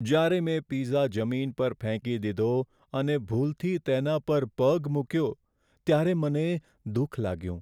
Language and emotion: Gujarati, sad